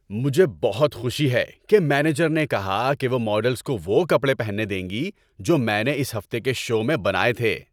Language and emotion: Urdu, happy